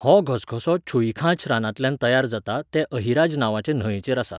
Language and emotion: Goan Konkani, neutral